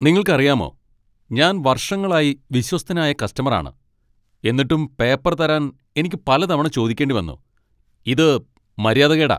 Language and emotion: Malayalam, angry